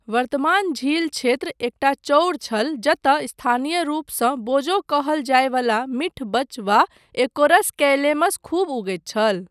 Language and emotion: Maithili, neutral